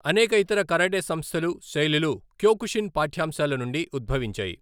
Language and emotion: Telugu, neutral